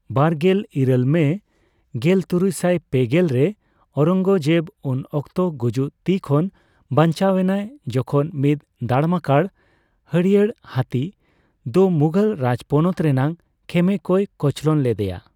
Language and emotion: Santali, neutral